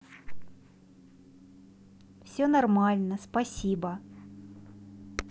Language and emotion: Russian, positive